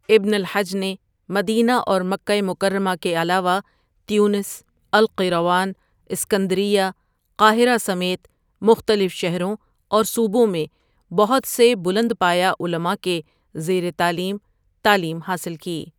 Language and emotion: Urdu, neutral